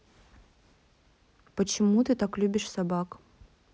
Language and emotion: Russian, neutral